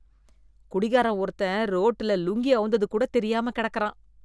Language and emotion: Tamil, disgusted